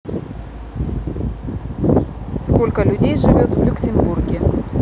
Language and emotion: Russian, neutral